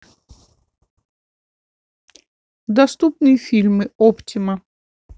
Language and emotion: Russian, neutral